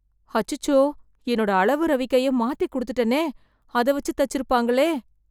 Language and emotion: Tamil, fearful